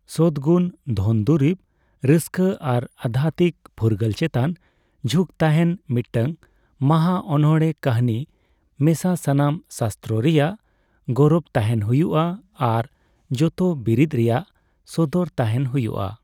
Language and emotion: Santali, neutral